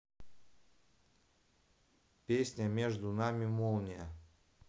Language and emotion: Russian, neutral